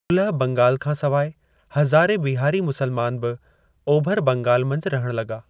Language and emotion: Sindhi, neutral